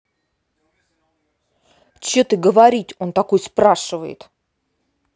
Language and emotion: Russian, angry